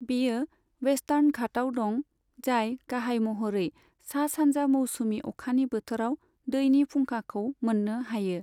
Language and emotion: Bodo, neutral